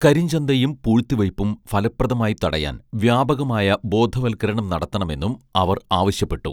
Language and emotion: Malayalam, neutral